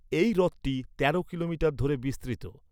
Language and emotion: Bengali, neutral